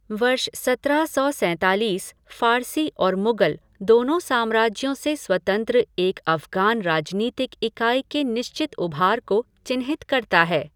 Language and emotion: Hindi, neutral